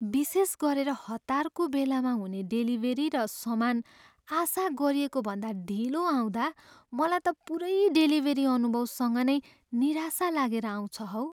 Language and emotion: Nepali, sad